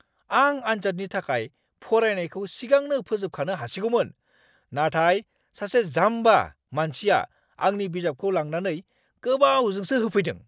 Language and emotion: Bodo, angry